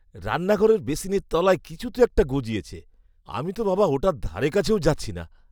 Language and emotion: Bengali, disgusted